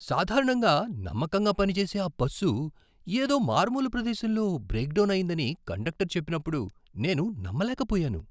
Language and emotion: Telugu, surprised